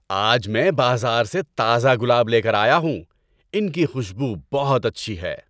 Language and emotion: Urdu, happy